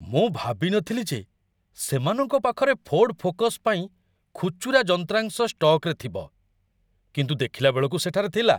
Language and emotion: Odia, surprised